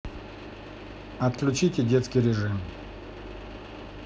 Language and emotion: Russian, neutral